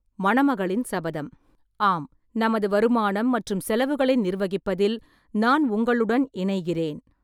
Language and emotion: Tamil, neutral